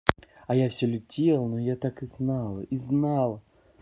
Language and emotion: Russian, positive